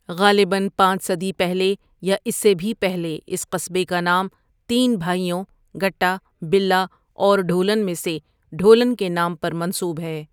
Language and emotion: Urdu, neutral